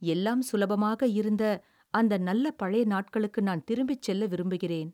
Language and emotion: Tamil, sad